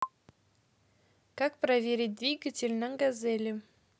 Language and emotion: Russian, positive